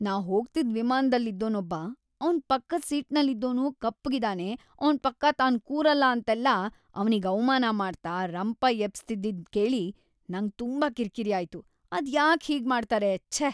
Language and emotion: Kannada, disgusted